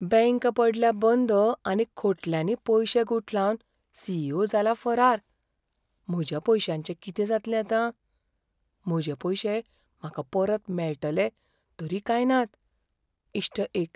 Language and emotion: Goan Konkani, fearful